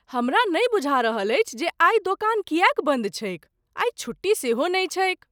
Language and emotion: Maithili, surprised